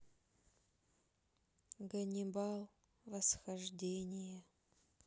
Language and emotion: Russian, sad